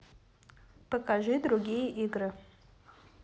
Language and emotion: Russian, neutral